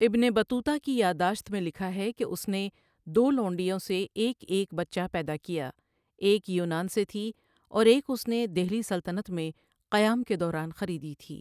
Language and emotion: Urdu, neutral